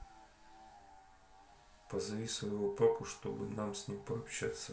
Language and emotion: Russian, neutral